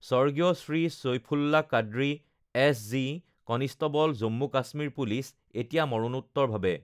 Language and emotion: Assamese, neutral